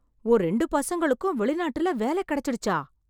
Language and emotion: Tamil, surprised